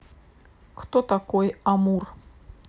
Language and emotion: Russian, neutral